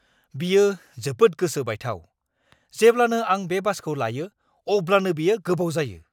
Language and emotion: Bodo, angry